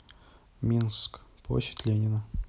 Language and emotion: Russian, neutral